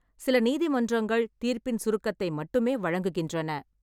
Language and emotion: Tamil, neutral